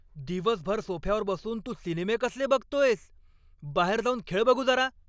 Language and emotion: Marathi, angry